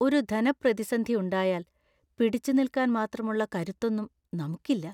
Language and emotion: Malayalam, fearful